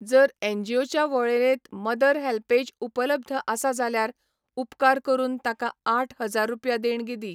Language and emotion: Goan Konkani, neutral